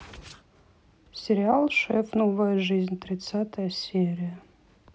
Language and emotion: Russian, neutral